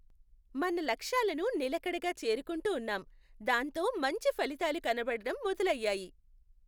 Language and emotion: Telugu, happy